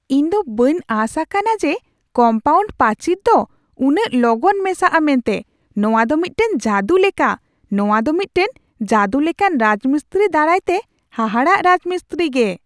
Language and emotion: Santali, surprised